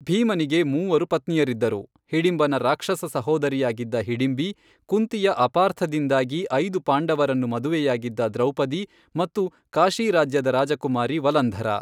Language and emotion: Kannada, neutral